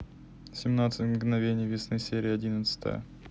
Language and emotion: Russian, neutral